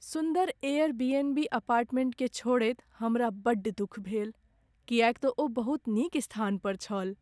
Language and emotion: Maithili, sad